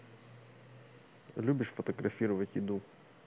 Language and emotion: Russian, neutral